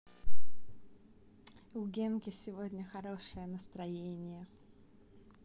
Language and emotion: Russian, positive